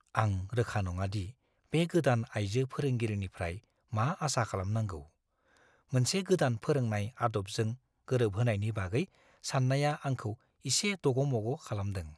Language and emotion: Bodo, fearful